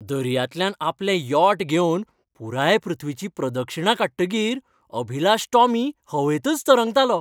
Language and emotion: Goan Konkani, happy